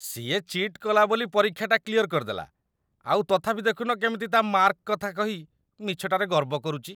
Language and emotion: Odia, disgusted